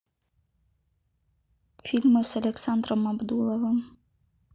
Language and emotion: Russian, neutral